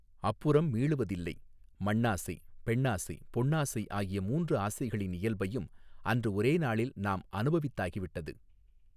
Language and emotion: Tamil, neutral